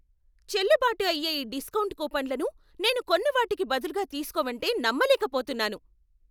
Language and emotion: Telugu, angry